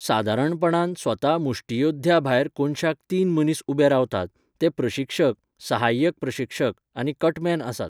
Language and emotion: Goan Konkani, neutral